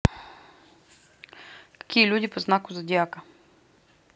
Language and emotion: Russian, neutral